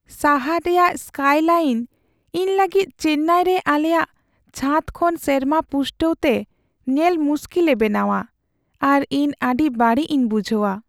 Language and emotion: Santali, sad